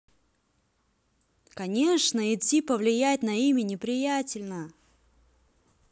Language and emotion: Russian, angry